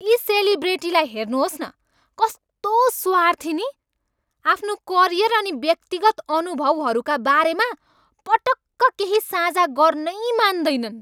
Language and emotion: Nepali, angry